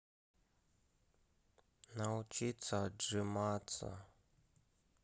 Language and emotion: Russian, sad